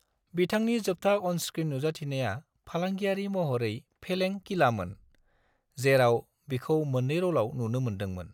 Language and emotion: Bodo, neutral